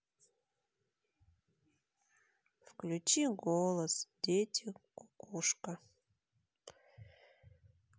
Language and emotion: Russian, sad